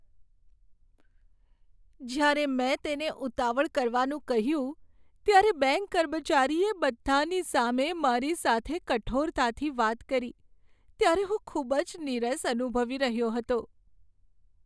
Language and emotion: Gujarati, sad